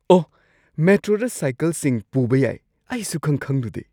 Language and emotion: Manipuri, surprised